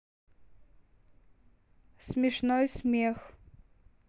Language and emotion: Russian, neutral